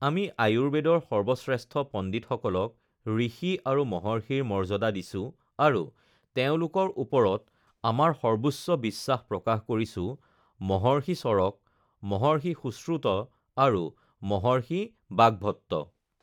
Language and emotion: Assamese, neutral